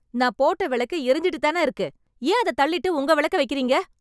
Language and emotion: Tamil, angry